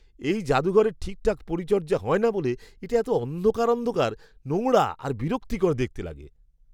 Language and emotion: Bengali, disgusted